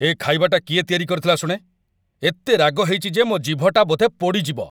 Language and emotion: Odia, angry